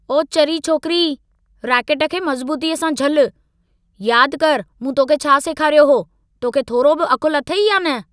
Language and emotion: Sindhi, angry